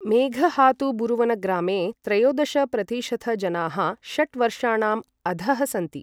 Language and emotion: Sanskrit, neutral